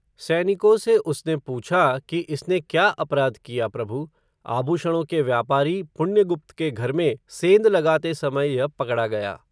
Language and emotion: Hindi, neutral